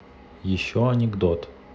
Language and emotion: Russian, neutral